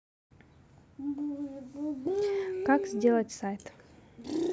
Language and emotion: Russian, neutral